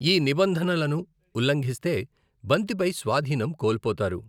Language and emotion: Telugu, neutral